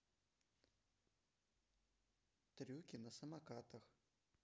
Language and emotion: Russian, neutral